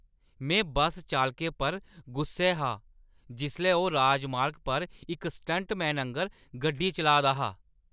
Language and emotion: Dogri, angry